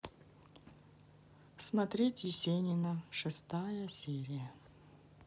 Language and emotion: Russian, neutral